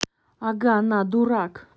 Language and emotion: Russian, angry